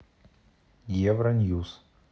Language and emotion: Russian, neutral